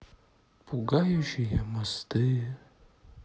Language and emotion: Russian, sad